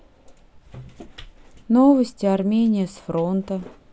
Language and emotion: Russian, sad